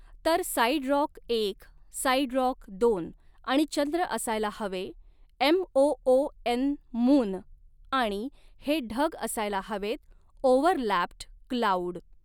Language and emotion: Marathi, neutral